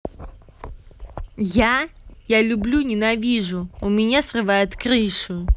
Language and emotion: Russian, angry